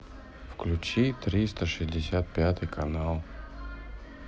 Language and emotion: Russian, neutral